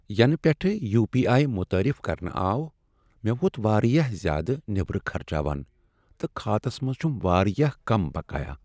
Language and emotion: Kashmiri, sad